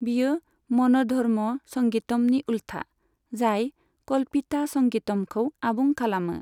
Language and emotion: Bodo, neutral